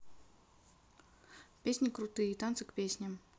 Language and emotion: Russian, neutral